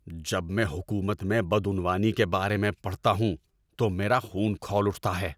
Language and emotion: Urdu, angry